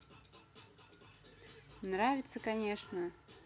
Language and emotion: Russian, positive